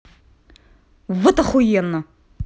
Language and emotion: Russian, angry